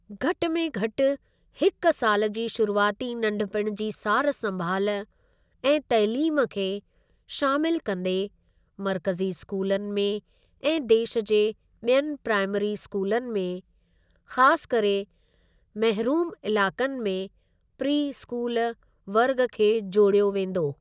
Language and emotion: Sindhi, neutral